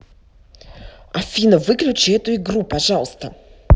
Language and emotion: Russian, angry